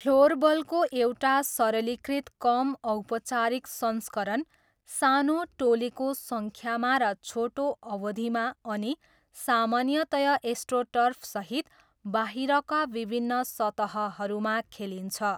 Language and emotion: Nepali, neutral